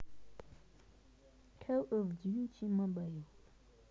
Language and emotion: Russian, neutral